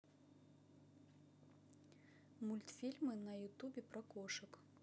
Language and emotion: Russian, neutral